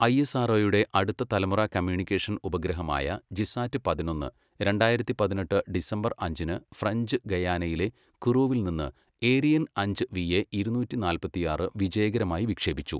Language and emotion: Malayalam, neutral